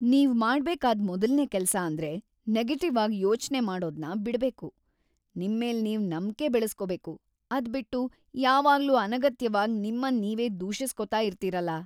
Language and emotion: Kannada, disgusted